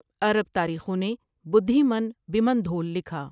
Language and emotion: Urdu, neutral